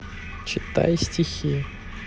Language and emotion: Russian, neutral